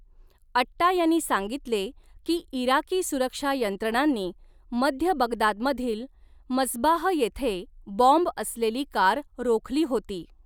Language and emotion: Marathi, neutral